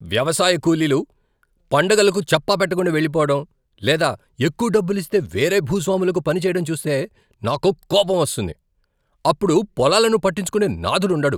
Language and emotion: Telugu, angry